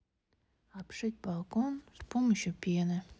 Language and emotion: Russian, sad